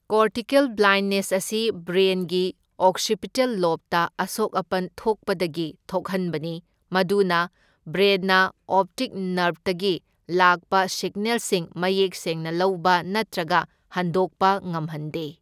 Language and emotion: Manipuri, neutral